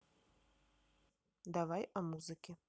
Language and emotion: Russian, neutral